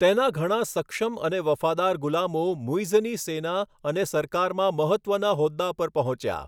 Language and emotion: Gujarati, neutral